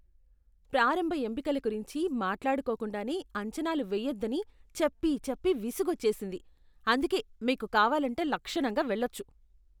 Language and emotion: Telugu, disgusted